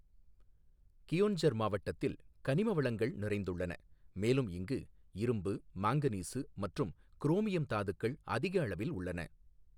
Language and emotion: Tamil, neutral